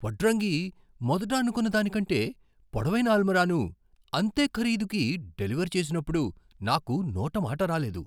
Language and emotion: Telugu, surprised